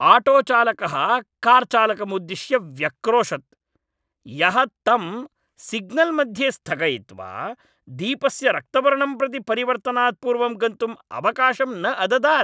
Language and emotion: Sanskrit, angry